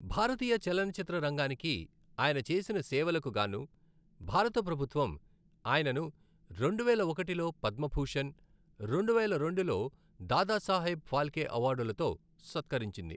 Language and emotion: Telugu, neutral